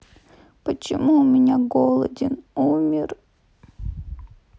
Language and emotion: Russian, sad